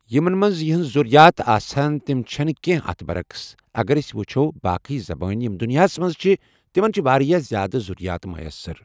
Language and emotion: Kashmiri, neutral